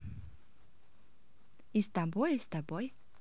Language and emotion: Russian, positive